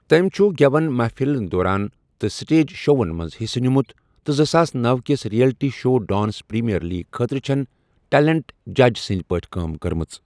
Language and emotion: Kashmiri, neutral